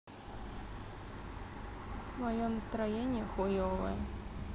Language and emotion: Russian, sad